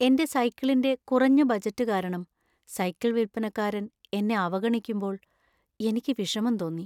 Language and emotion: Malayalam, sad